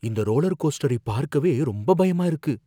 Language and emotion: Tamil, fearful